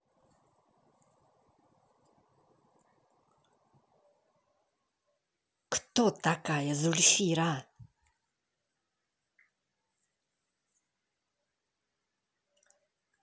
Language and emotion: Russian, angry